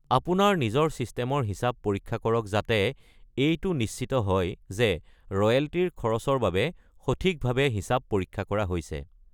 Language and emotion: Assamese, neutral